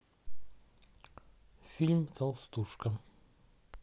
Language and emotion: Russian, neutral